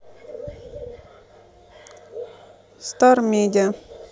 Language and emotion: Russian, neutral